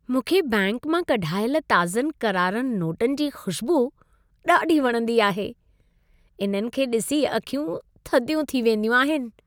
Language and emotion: Sindhi, happy